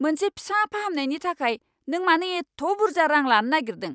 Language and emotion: Bodo, angry